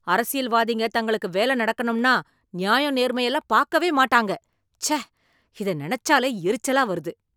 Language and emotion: Tamil, angry